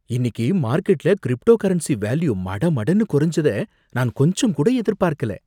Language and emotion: Tamil, surprised